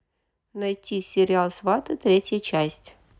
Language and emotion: Russian, neutral